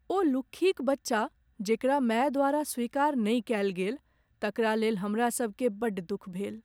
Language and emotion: Maithili, sad